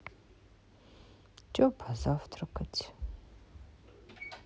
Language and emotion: Russian, sad